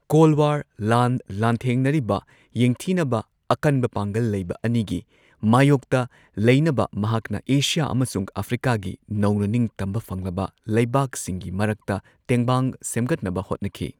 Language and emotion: Manipuri, neutral